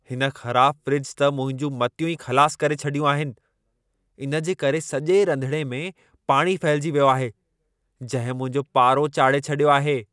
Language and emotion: Sindhi, angry